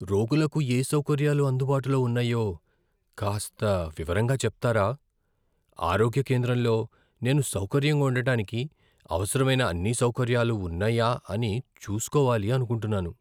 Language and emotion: Telugu, fearful